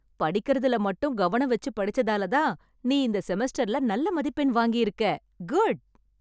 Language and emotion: Tamil, happy